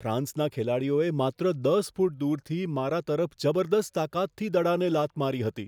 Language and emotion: Gujarati, fearful